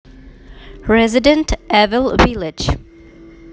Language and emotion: Russian, neutral